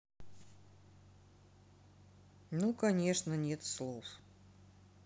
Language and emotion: Russian, neutral